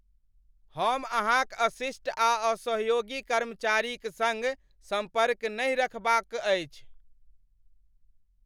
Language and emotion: Maithili, angry